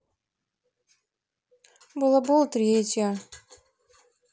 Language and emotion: Russian, neutral